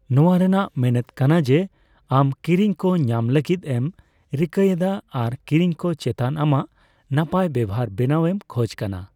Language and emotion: Santali, neutral